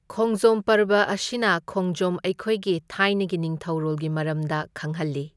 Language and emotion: Manipuri, neutral